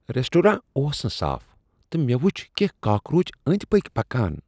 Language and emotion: Kashmiri, disgusted